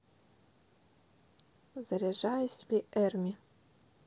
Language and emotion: Russian, neutral